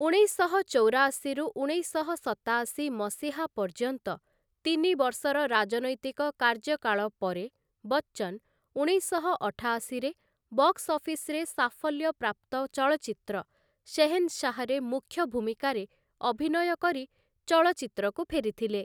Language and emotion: Odia, neutral